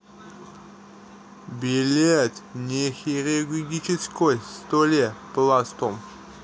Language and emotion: Russian, neutral